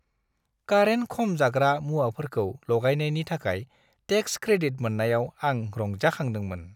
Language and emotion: Bodo, happy